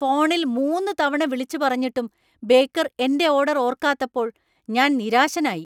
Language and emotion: Malayalam, angry